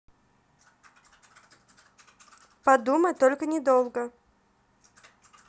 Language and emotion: Russian, neutral